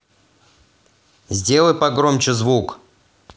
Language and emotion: Russian, angry